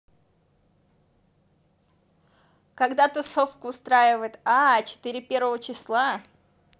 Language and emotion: Russian, positive